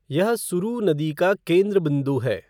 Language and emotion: Hindi, neutral